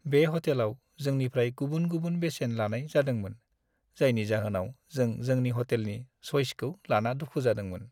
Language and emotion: Bodo, sad